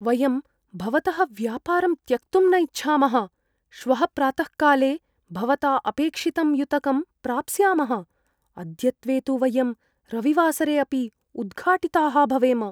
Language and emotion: Sanskrit, fearful